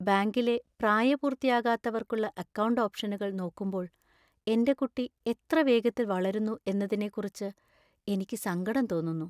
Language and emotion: Malayalam, sad